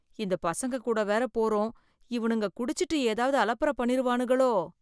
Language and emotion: Tamil, fearful